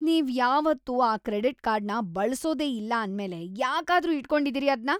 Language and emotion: Kannada, disgusted